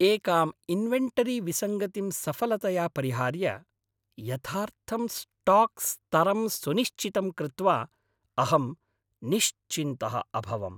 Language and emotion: Sanskrit, happy